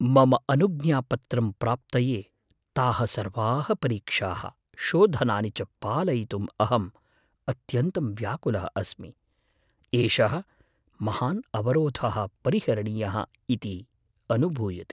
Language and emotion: Sanskrit, fearful